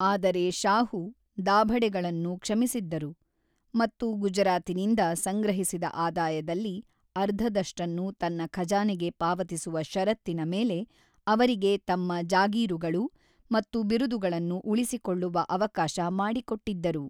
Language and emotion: Kannada, neutral